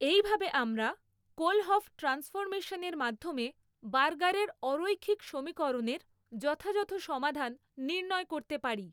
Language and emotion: Bengali, neutral